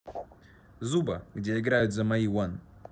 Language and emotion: Russian, neutral